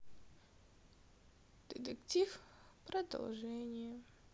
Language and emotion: Russian, sad